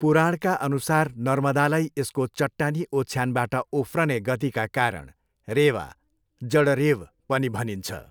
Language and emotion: Nepali, neutral